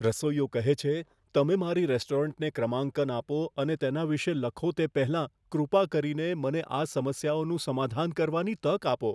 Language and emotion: Gujarati, fearful